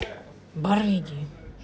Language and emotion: Russian, angry